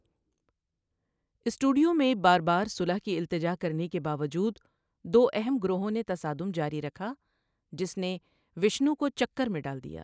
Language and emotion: Urdu, neutral